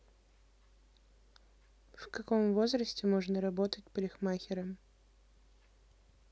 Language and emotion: Russian, neutral